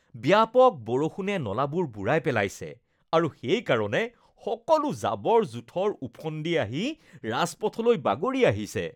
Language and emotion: Assamese, disgusted